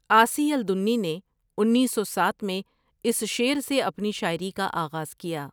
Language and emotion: Urdu, neutral